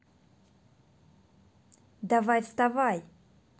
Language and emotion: Russian, neutral